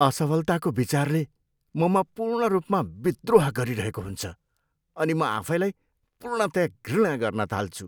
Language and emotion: Nepali, disgusted